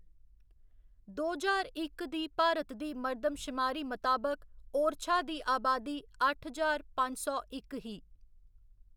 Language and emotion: Dogri, neutral